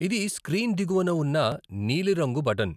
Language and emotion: Telugu, neutral